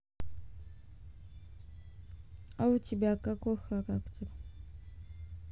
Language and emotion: Russian, neutral